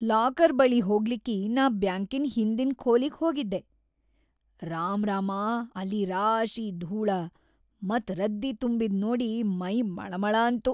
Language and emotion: Kannada, disgusted